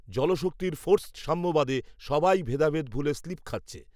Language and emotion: Bengali, neutral